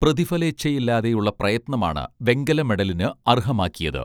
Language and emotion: Malayalam, neutral